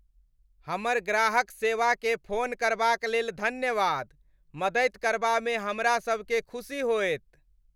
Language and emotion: Maithili, happy